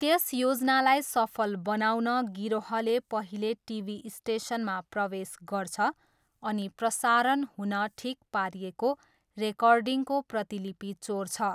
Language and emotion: Nepali, neutral